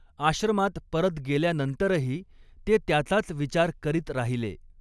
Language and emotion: Marathi, neutral